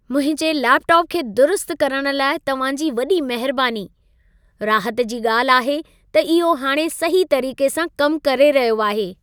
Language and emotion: Sindhi, happy